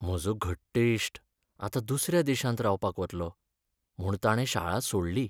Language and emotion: Goan Konkani, sad